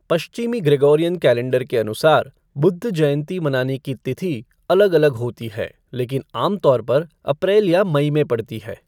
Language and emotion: Hindi, neutral